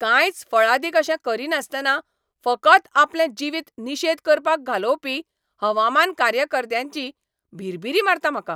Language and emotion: Goan Konkani, angry